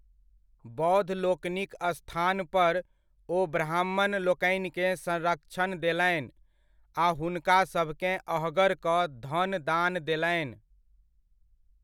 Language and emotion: Maithili, neutral